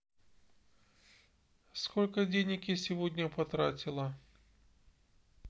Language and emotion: Russian, neutral